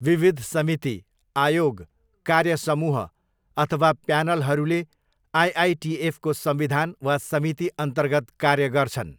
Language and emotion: Nepali, neutral